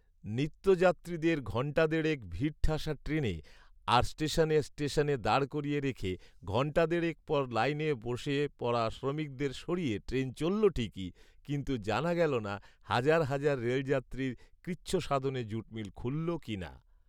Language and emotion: Bengali, neutral